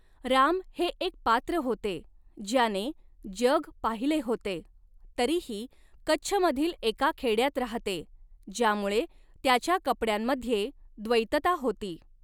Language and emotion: Marathi, neutral